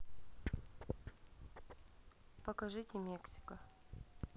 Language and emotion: Russian, neutral